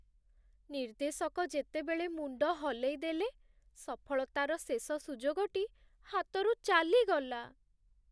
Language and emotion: Odia, sad